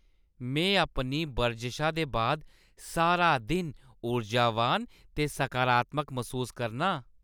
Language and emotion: Dogri, happy